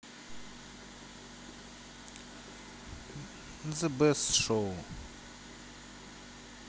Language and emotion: Russian, neutral